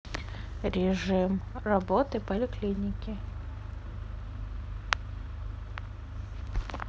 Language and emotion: Russian, neutral